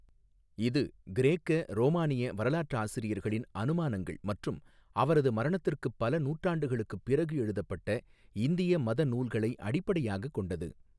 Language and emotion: Tamil, neutral